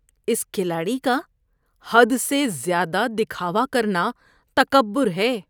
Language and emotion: Urdu, disgusted